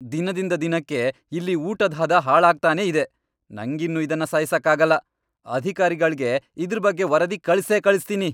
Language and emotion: Kannada, angry